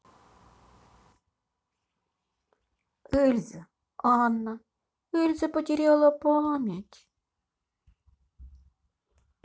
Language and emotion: Russian, sad